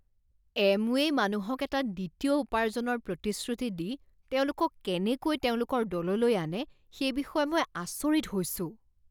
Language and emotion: Assamese, disgusted